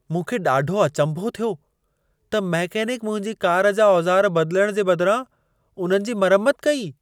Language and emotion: Sindhi, surprised